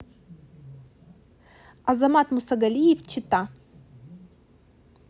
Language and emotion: Russian, neutral